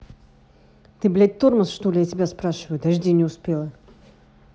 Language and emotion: Russian, angry